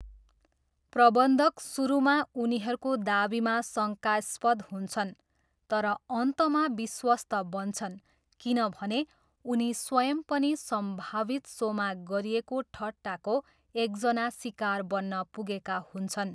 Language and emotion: Nepali, neutral